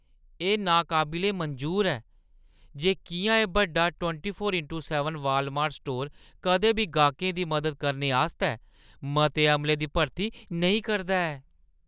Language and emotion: Dogri, disgusted